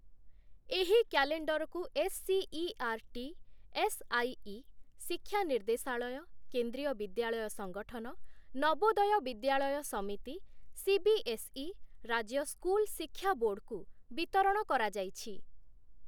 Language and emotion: Odia, neutral